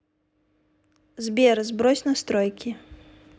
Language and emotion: Russian, neutral